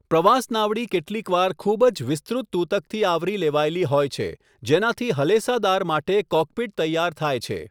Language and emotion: Gujarati, neutral